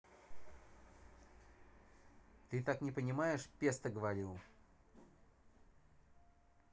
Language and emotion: Russian, angry